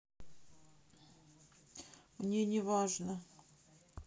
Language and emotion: Russian, sad